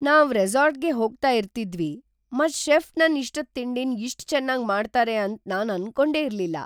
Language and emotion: Kannada, surprised